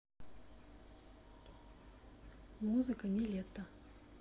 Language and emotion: Russian, neutral